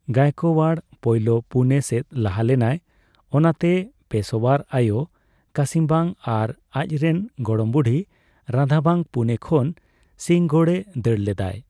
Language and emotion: Santali, neutral